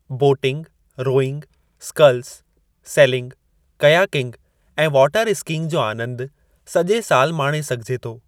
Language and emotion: Sindhi, neutral